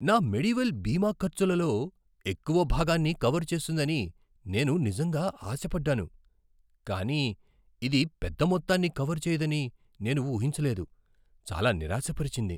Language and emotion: Telugu, surprised